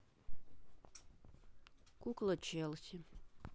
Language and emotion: Russian, sad